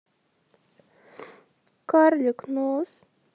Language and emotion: Russian, sad